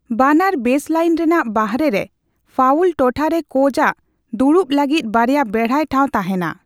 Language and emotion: Santali, neutral